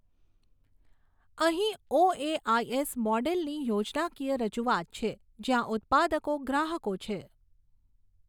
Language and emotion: Gujarati, neutral